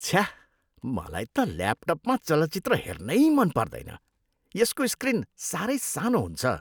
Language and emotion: Nepali, disgusted